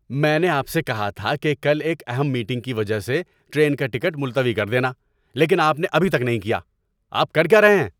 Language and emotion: Urdu, angry